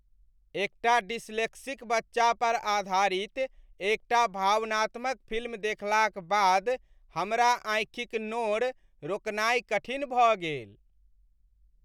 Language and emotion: Maithili, sad